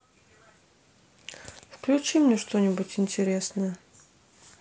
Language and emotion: Russian, neutral